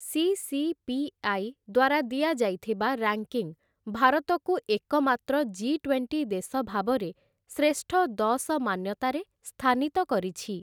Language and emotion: Odia, neutral